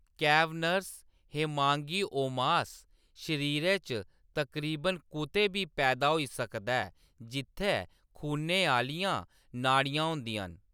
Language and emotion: Dogri, neutral